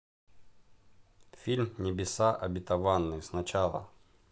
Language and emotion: Russian, neutral